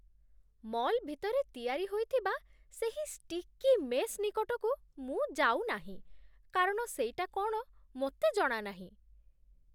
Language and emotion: Odia, disgusted